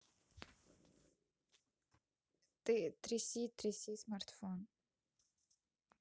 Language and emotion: Russian, neutral